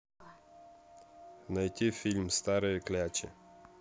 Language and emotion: Russian, neutral